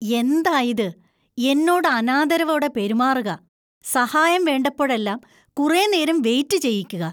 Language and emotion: Malayalam, disgusted